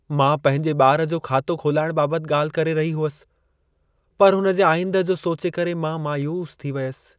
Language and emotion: Sindhi, sad